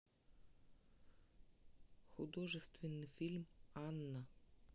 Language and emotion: Russian, neutral